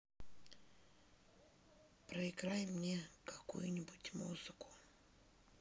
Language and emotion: Russian, neutral